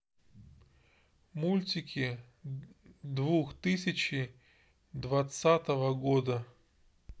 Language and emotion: Russian, neutral